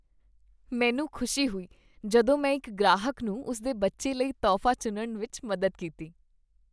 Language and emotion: Punjabi, happy